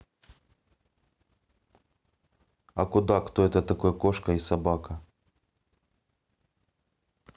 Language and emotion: Russian, neutral